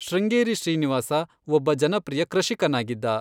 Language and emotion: Kannada, neutral